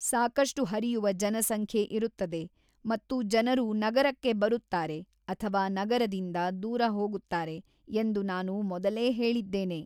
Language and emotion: Kannada, neutral